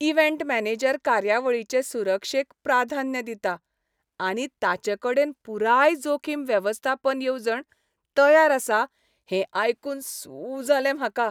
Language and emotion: Goan Konkani, happy